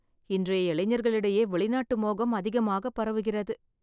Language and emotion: Tamil, sad